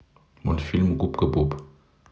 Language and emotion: Russian, neutral